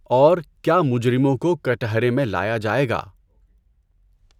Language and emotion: Urdu, neutral